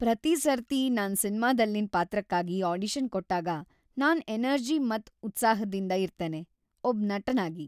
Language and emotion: Kannada, happy